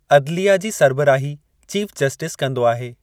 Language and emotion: Sindhi, neutral